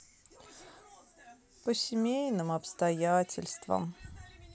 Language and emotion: Russian, sad